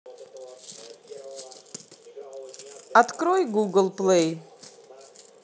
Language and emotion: Russian, neutral